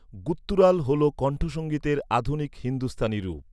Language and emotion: Bengali, neutral